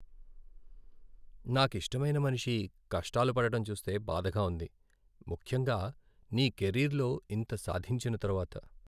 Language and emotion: Telugu, sad